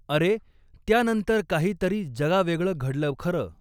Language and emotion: Marathi, neutral